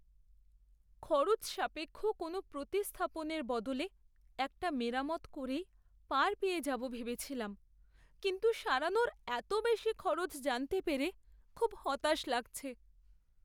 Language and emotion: Bengali, sad